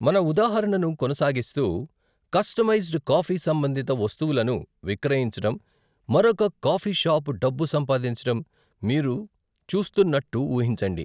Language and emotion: Telugu, neutral